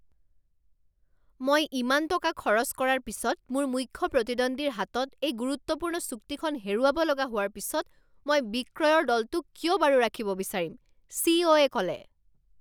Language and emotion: Assamese, angry